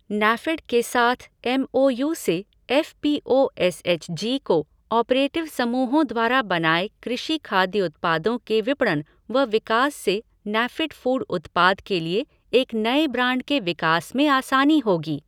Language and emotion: Hindi, neutral